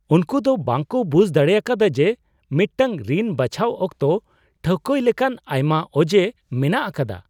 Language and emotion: Santali, surprised